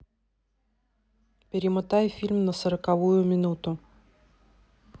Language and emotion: Russian, neutral